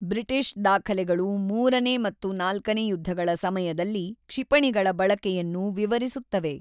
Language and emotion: Kannada, neutral